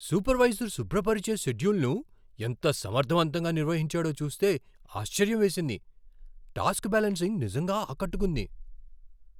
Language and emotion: Telugu, surprised